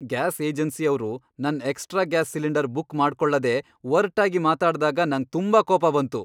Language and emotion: Kannada, angry